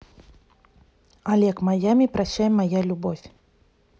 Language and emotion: Russian, neutral